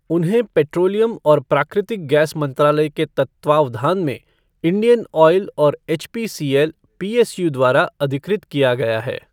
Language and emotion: Hindi, neutral